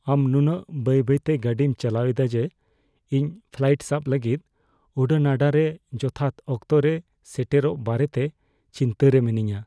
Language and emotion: Santali, fearful